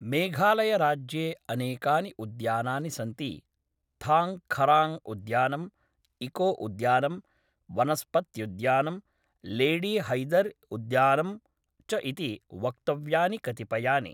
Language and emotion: Sanskrit, neutral